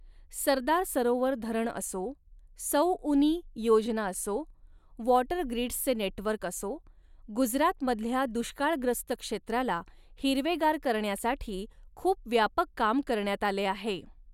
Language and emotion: Marathi, neutral